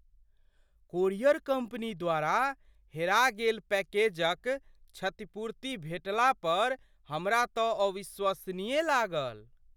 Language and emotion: Maithili, surprised